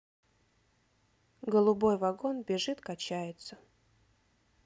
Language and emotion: Russian, neutral